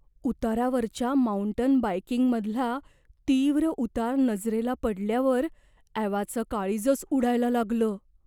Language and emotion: Marathi, fearful